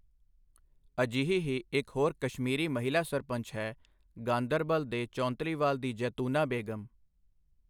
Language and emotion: Punjabi, neutral